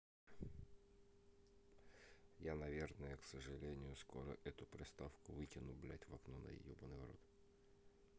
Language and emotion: Russian, neutral